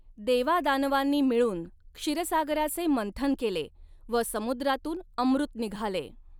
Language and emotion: Marathi, neutral